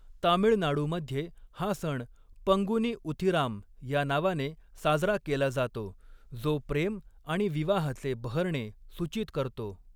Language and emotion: Marathi, neutral